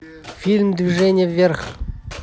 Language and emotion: Russian, neutral